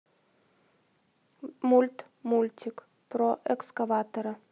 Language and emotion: Russian, neutral